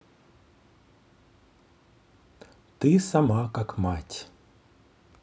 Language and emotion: Russian, neutral